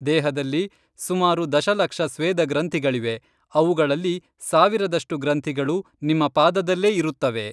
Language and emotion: Kannada, neutral